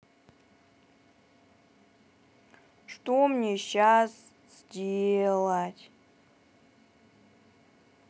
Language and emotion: Russian, sad